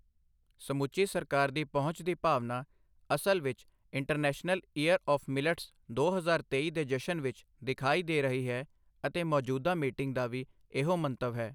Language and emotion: Punjabi, neutral